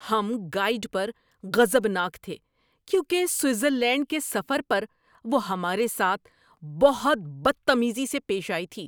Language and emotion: Urdu, angry